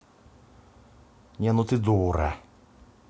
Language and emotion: Russian, angry